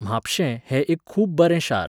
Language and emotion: Goan Konkani, neutral